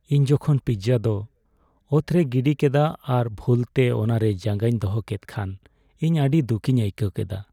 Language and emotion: Santali, sad